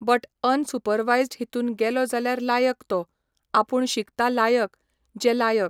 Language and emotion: Goan Konkani, neutral